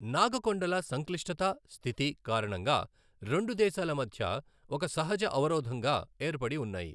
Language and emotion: Telugu, neutral